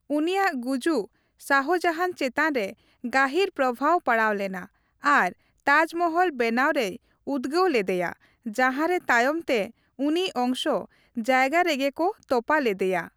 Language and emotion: Santali, neutral